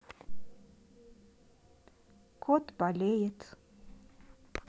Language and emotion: Russian, sad